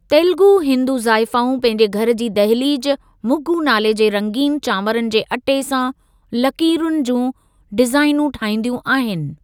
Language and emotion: Sindhi, neutral